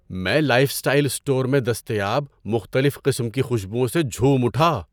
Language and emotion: Urdu, surprised